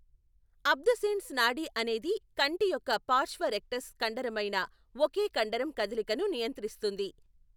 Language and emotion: Telugu, neutral